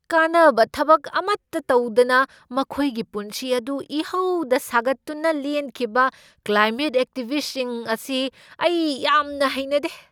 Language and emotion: Manipuri, angry